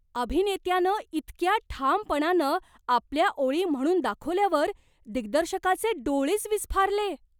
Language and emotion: Marathi, surprised